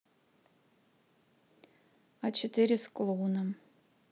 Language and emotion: Russian, neutral